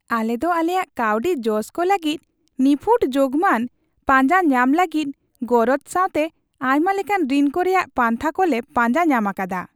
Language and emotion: Santali, happy